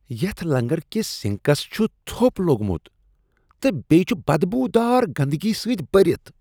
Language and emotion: Kashmiri, disgusted